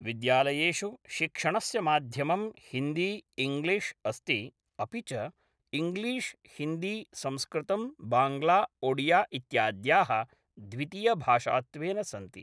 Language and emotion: Sanskrit, neutral